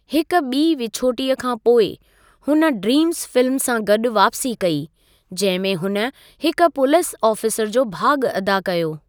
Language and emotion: Sindhi, neutral